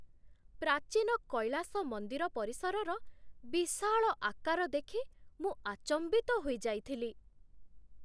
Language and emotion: Odia, surprised